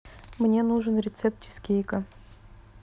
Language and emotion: Russian, neutral